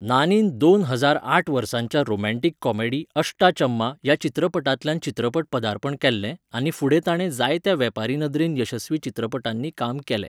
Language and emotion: Goan Konkani, neutral